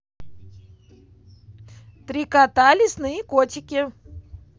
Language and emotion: Russian, positive